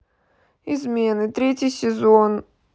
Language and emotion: Russian, sad